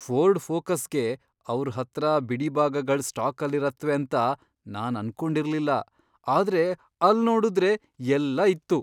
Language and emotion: Kannada, surprised